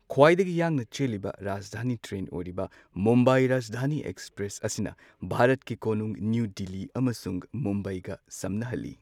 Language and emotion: Manipuri, neutral